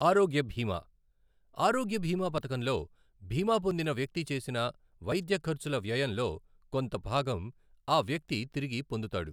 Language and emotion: Telugu, neutral